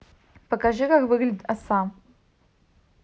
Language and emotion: Russian, neutral